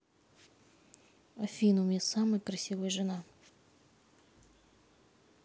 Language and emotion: Russian, neutral